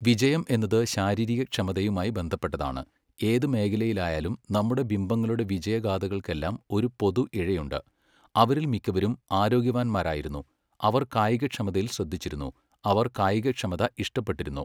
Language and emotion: Malayalam, neutral